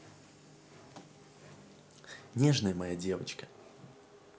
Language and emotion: Russian, positive